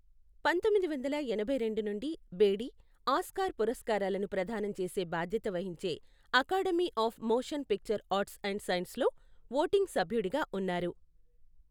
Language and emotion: Telugu, neutral